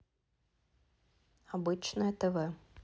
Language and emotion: Russian, neutral